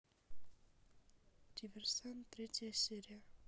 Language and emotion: Russian, neutral